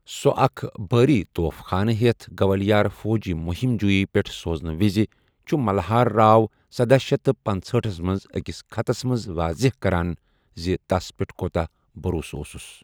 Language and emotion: Kashmiri, neutral